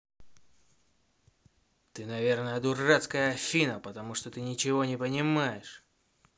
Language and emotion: Russian, angry